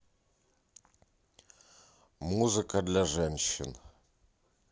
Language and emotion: Russian, neutral